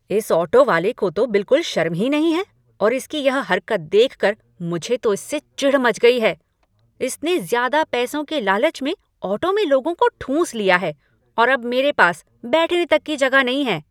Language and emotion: Hindi, angry